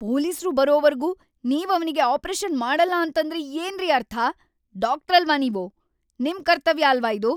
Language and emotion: Kannada, angry